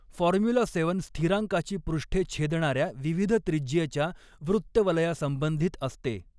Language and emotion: Marathi, neutral